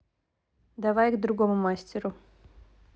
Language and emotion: Russian, neutral